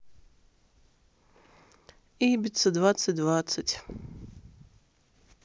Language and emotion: Russian, sad